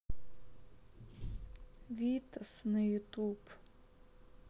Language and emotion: Russian, sad